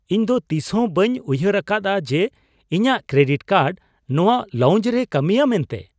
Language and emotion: Santali, surprised